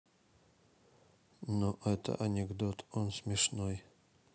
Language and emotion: Russian, sad